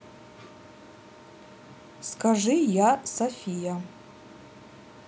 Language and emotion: Russian, neutral